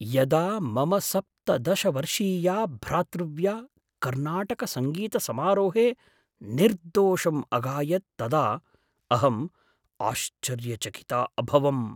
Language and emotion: Sanskrit, surprised